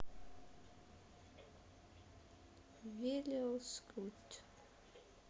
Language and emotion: Russian, sad